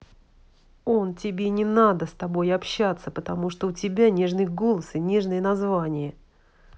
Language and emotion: Russian, angry